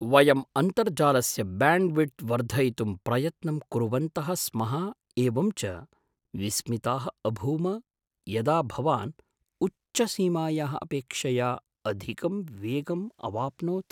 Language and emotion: Sanskrit, surprised